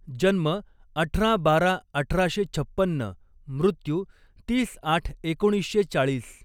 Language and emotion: Marathi, neutral